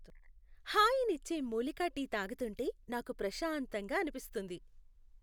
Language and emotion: Telugu, happy